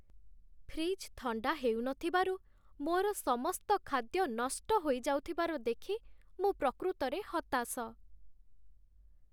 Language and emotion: Odia, sad